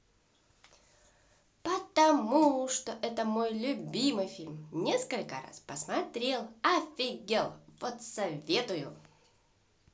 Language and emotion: Russian, positive